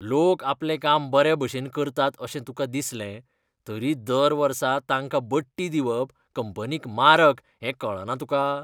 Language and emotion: Goan Konkani, disgusted